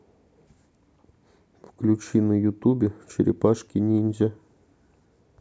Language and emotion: Russian, neutral